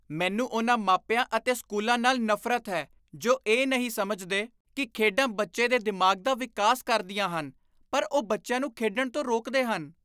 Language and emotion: Punjabi, disgusted